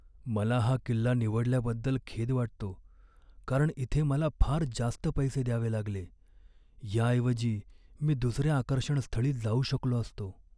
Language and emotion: Marathi, sad